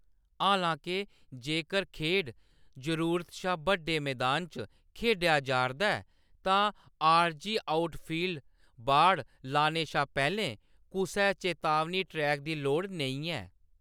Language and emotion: Dogri, neutral